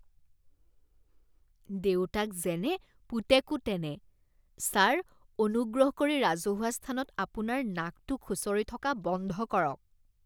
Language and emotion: Assamese, disgusted